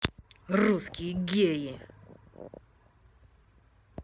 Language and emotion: Russian, angry